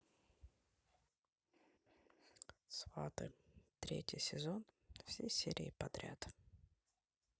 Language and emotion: Russian, neutral